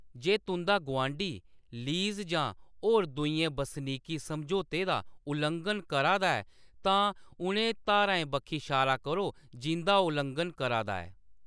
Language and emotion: Dogri, neutral